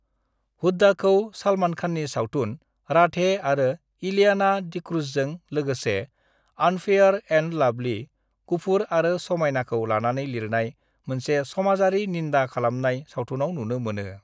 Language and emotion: Bodo, neutral